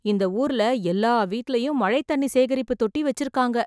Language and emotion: Tamil, surprised